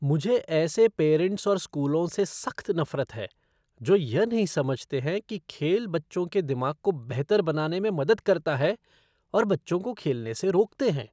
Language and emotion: Hindi, disgusted